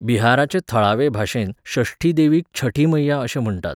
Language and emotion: Goan Konkani, neutral